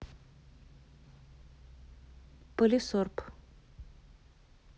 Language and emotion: Russian, neutral